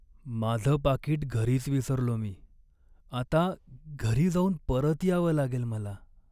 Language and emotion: Marathi, sad